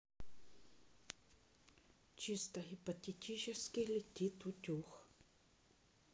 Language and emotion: Russian, neutral